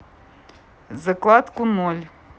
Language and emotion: Russian, neutral